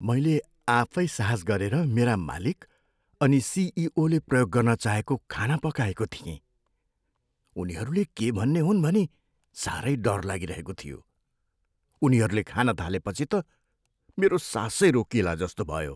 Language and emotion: Nepali, fearful